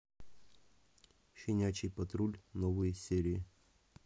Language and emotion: Russian, neutral